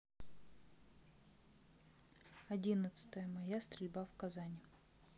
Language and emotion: Russian, sad